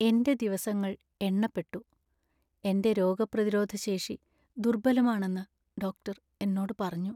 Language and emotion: Malayalam, sad